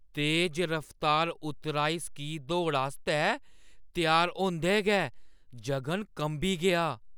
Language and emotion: Dogri, fearful